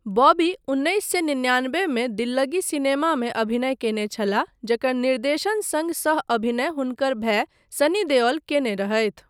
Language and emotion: Maithili, neutral